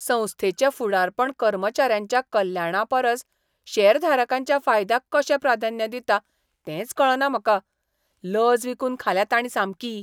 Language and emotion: Goan Konkani, disgusted